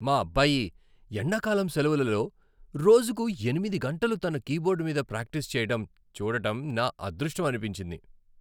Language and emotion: Telugu, happy